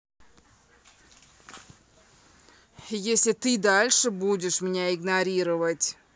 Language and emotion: Russian, angry